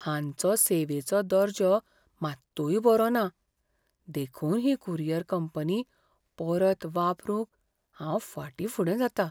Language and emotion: Goan Konkani, fearful